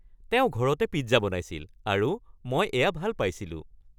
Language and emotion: Assamese, happy